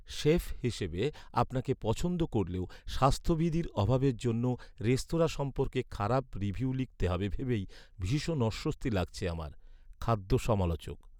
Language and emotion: Bengali, sad